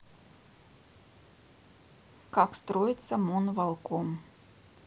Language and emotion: Russian, neutral